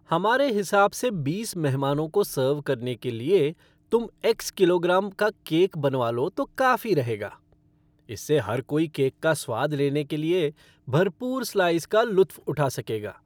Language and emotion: Hindi, happy